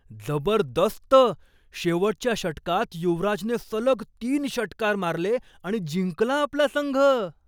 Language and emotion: Marathi, surprised